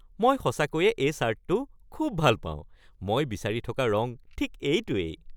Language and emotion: Assamese, happy